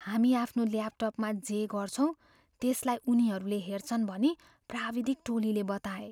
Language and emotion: Nepali, fearful